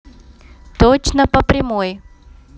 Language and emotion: Russian, neutral